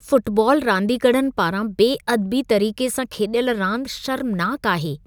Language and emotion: Sindhi, disgusted